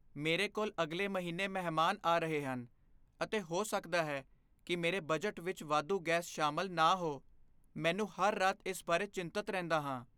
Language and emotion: Punjabi, fearful